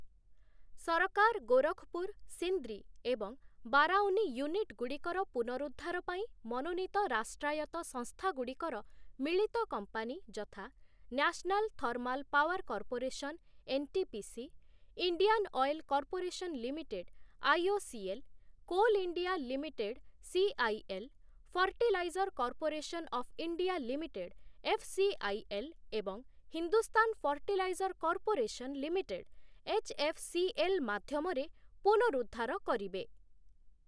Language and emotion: Odia, neutral